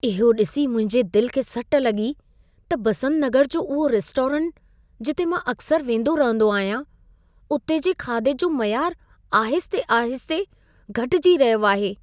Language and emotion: Sindhi, sad